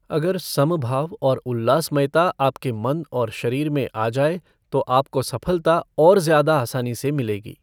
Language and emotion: Hindi, neutral